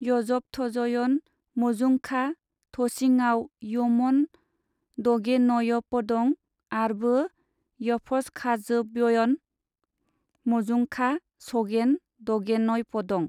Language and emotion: Bodo, neutral